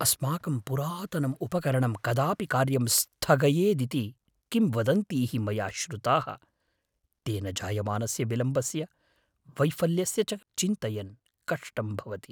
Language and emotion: Sanskrit, fearful